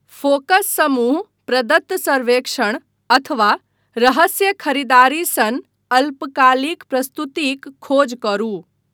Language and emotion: Maithili, neutral